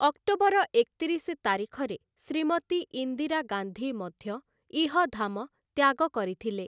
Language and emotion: Odia, neutral